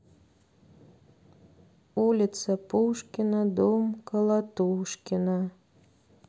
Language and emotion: Russian, sad